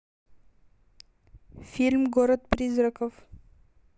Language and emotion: Russian, neutral